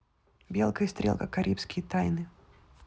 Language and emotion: Russian, neutral